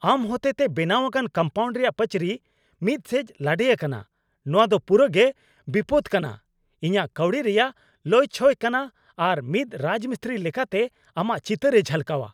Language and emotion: Santali, angry